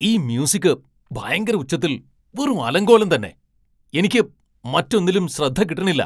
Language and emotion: Malayalam, angry